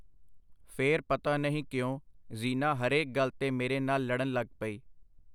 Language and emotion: Punjabi, neutral